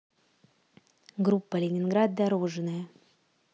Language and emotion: Russian, neutral